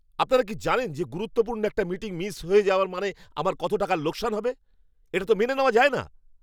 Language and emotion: Bengali, angry